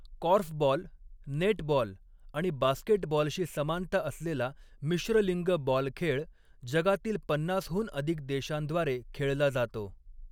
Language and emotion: Marathi, neutral